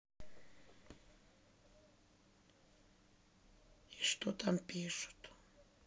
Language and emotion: Russian, sad